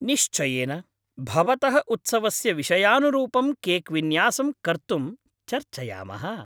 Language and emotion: Sanskrit, happy